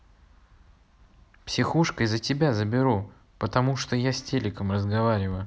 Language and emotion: Russian, neutral